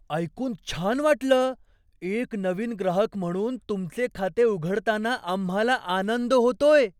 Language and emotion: Marathi, surprised